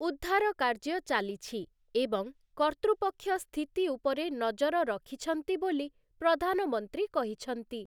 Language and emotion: Odia, neutral